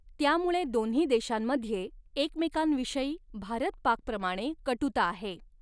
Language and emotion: Marathi, neutral